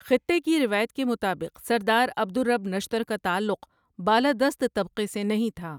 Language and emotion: Urdu, neutral